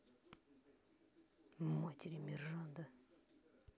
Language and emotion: Russian, neutral